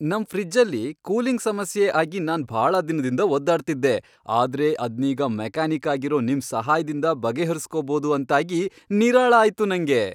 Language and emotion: Kannada, happy